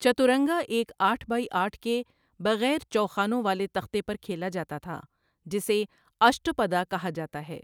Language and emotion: Urdu, neutral